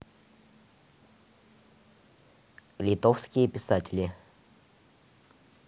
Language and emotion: Russian, neutral